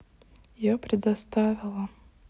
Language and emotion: Russian, sad